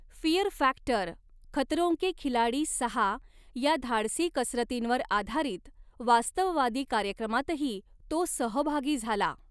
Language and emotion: Marathi, neutral